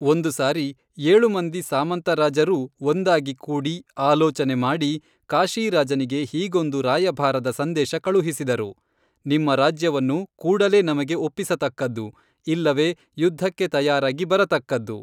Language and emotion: Kannada, neutral